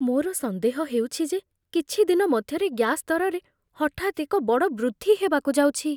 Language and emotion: Odia, fearful